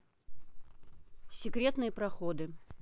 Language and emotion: Russian, neutral